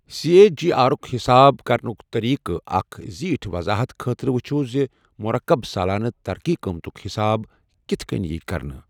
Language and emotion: Kashmiri, neutral